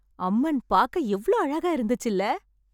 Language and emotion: Tamil, happy